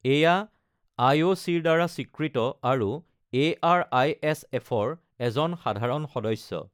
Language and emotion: Assamese, neutral